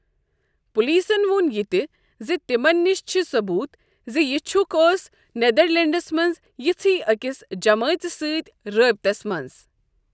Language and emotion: Kashmiri, neutral